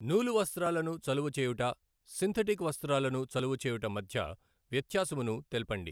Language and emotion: Telugu, neutral